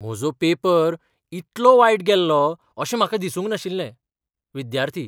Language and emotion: Goan Konkani, surprised